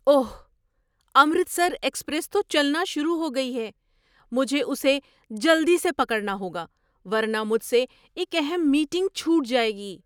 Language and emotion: Urdu, surprised